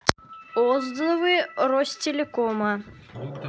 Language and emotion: Russian, neutral